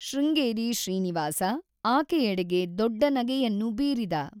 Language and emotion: Kannada, neutral